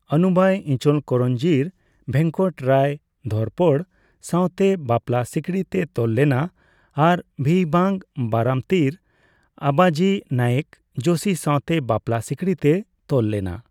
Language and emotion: Santali, neutral